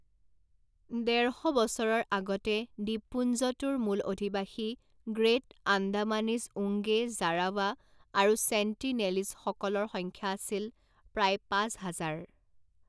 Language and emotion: Assamese, neutral